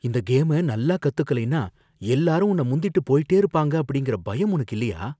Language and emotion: Tamil, fearful